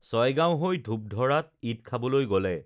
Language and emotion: Assamese, neutral